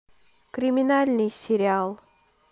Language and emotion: Russian, neutral